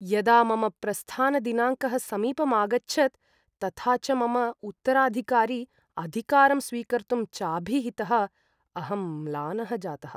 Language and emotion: Sanskrit, sad